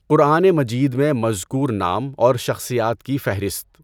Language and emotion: Urdu, neutral